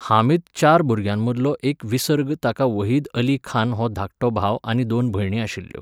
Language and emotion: Goan Konkani, neutral